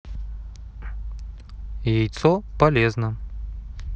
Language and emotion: Russian, neutral